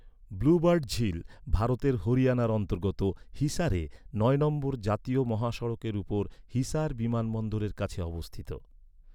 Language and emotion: Bengali, neutral